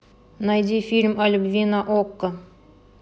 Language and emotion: Russian, neutral